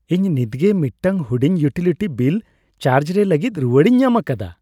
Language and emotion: Santali, happy